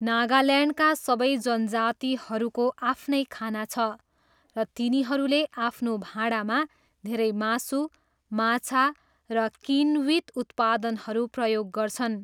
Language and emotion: Nepali, neutral